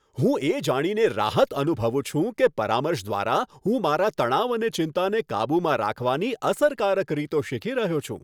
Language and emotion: Gujarati, happy